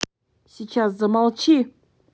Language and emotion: Russian, angry